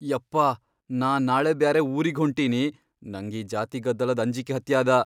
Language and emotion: Kannada, fearful